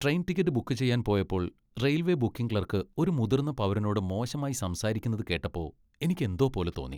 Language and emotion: Malayalam, disgusted